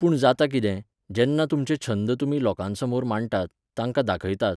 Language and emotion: Goan Konkani, neutral